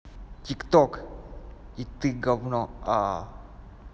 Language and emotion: Russian, angry